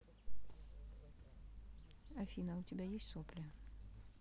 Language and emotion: Russian, neutral